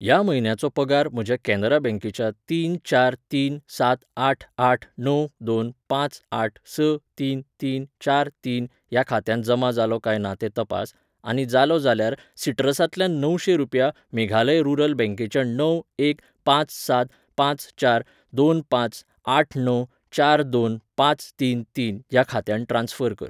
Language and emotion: Goan Konkani, neutral